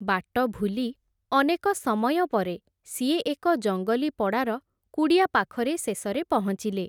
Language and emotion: Odia, neutral